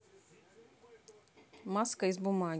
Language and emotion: Russian, neutral